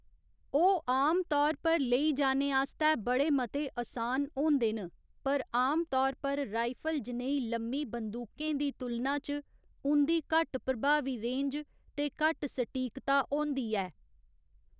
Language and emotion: Dogri, neutral